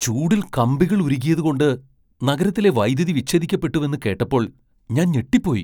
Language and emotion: Malayalam, surprised